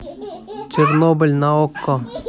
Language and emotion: Russian, neutral